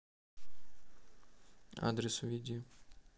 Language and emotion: Russian, neutral